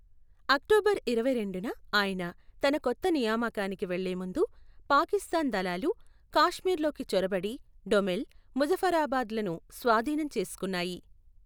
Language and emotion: Telugu, neutral